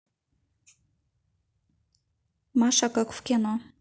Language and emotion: Russian, neutral